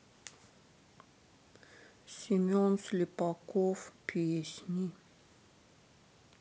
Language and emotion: Russian, sad